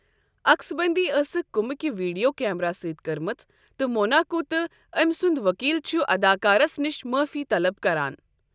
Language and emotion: Kashmiri, neutral